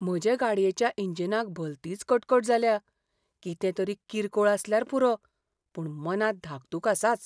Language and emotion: Goan Konkani, fearful